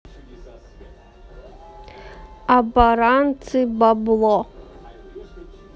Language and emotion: Russian, neutral